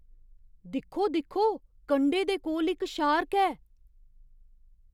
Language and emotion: Dogri, surprised